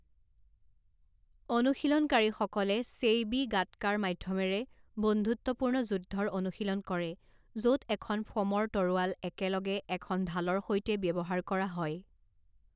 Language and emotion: Assamese, neutral